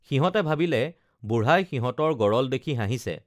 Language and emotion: Assamese, neutral